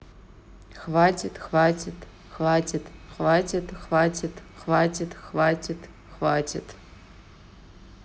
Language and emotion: Russian, neutral